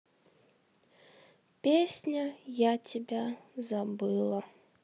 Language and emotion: Russian, sad